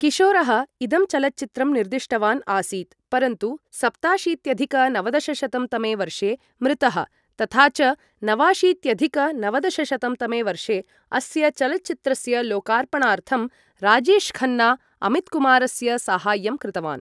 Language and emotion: Sanskrit, neutral